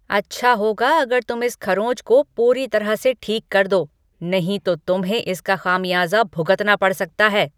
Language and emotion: Hindi, angry